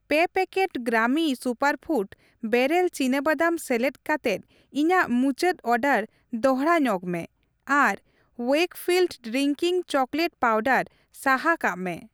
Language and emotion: Santali, neutral